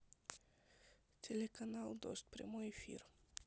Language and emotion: Russian, neutral